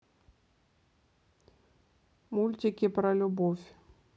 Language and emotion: Russian, neutral